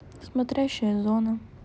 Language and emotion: Russian, neutral